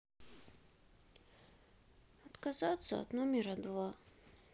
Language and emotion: Russian, sad